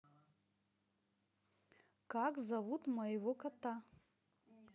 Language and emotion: Russian, positive